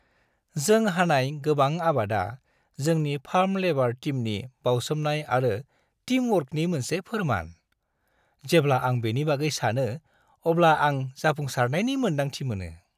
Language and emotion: Bodo, happy